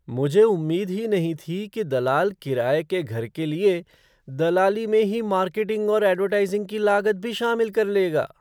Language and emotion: Hindi, surprised